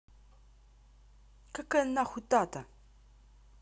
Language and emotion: Russian, angry